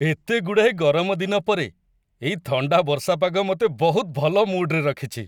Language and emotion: Odia, happy